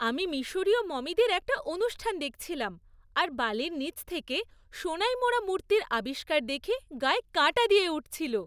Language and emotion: Bengali, happy